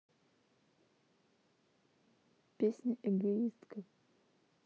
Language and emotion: Russian, neutral